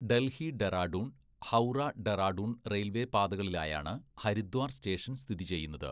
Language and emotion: Malayalam, neutral